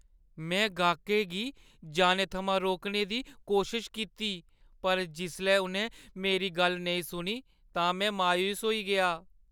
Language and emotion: Dogri, sad